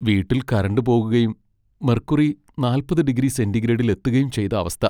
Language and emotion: Malayalam, sad